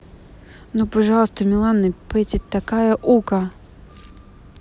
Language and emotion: Russian, neutral